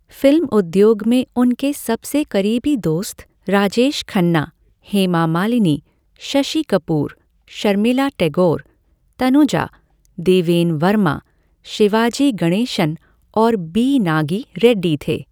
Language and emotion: Hindi, neutral